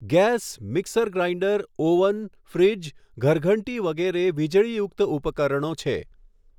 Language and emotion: Gujarati, neutral